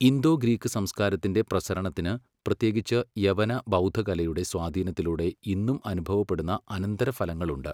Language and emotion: Malayalam, neutral